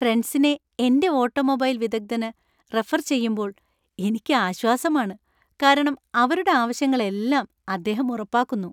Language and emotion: Malayalam, happy